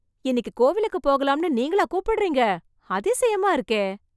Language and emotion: Tamil, surprised